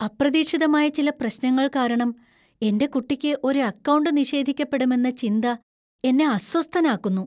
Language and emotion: Malayalam, fearful